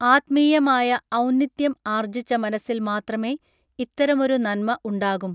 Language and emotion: Malayalam, neutral